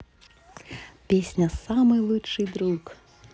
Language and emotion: Russian, positive